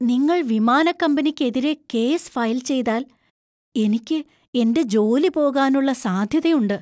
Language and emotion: Malayalam, fearful